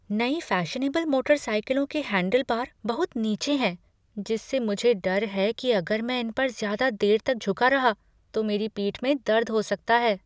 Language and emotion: Hindi, fearful